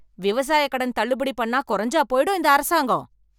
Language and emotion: Tamil, angry